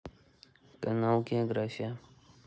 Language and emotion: Russian, neutral